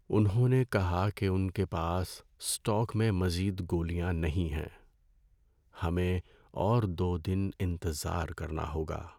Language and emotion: Urdu, sad